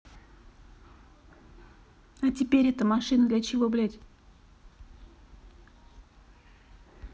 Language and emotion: Russian, neutral